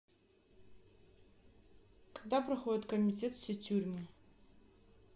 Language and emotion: Russian, neutral